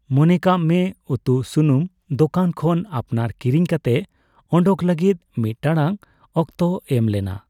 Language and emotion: Santali, neutral